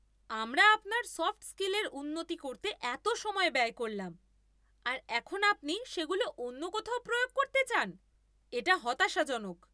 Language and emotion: Bengali, angry